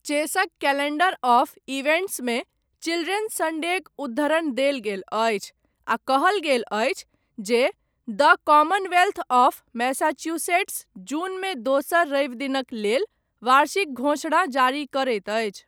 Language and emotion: Maithili, neutral